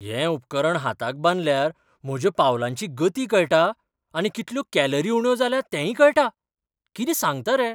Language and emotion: Goan Konkani, surprised